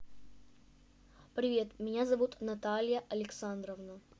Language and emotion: Russian, neutral